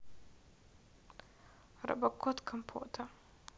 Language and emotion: Russian, sad